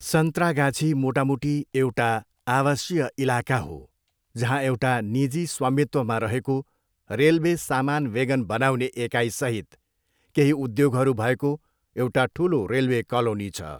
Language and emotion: Nepali, neutral